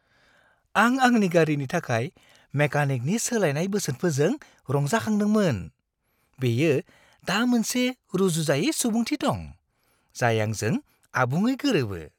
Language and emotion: Bodo, happy